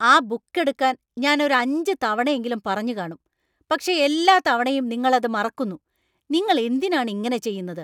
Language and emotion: Malayalam, angry